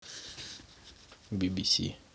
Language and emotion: Russian, neutral